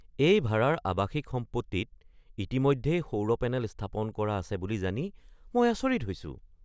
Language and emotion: Assamese, surprised